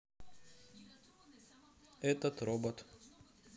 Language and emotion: Russian, neutral